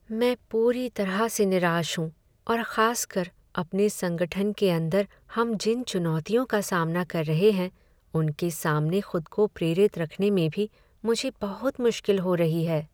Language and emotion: Hindi, sad